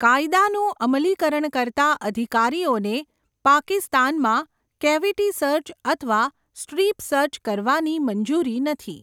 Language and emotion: Gujarati, neutral